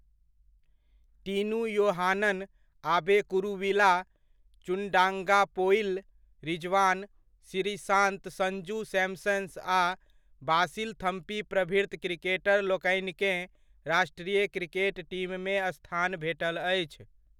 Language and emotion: Maithili, neutral